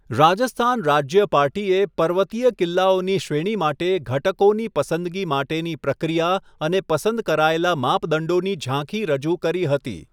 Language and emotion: Gujarati, neutral